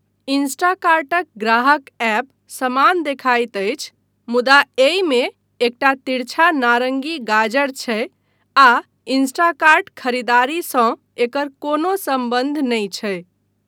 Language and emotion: Maithili, neutral